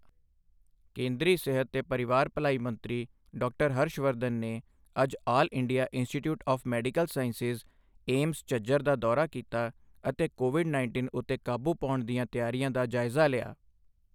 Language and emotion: Punjabi, neutral